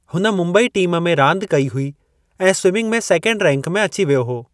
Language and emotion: Sindhi, neutral